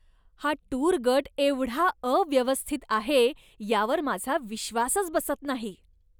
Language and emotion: Marathi, disgusted